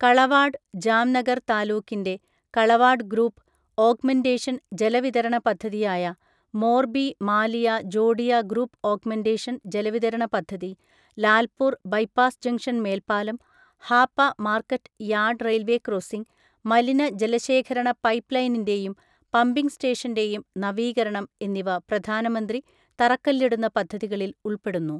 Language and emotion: Malayalam, neutral